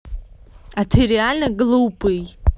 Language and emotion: Russian, angry